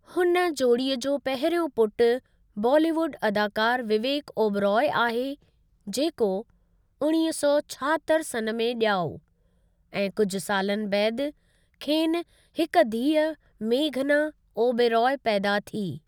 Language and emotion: Sindhi, neutral